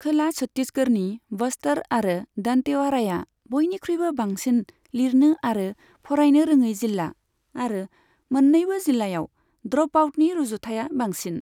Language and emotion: Bodo, neutral